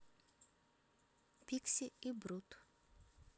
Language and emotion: Russian, neutral